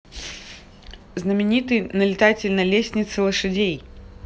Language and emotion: Russian, neutral